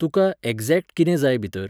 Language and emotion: Goan Konkani, neutral